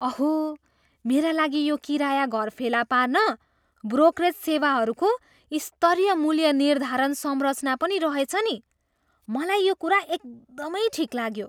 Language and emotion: Nepali, surprised